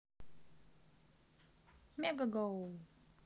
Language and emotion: Russian, positive